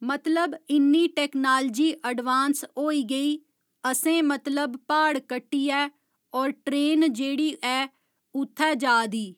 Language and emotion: Dogri, neutral